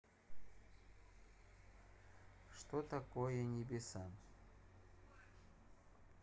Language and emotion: Russian, neutral